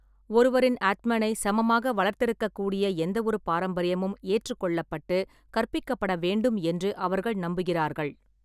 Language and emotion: Tamil, neutral